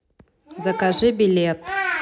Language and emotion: Russian, neutral